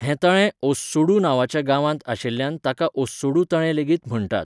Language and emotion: Goan Konkani, neutral